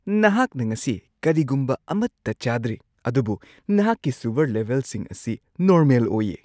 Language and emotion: Manipuri, surprised